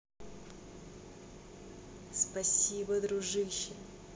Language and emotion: Russian, positive